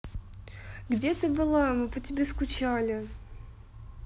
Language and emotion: Russian, neutral